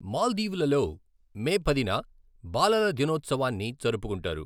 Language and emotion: Telugu, neutral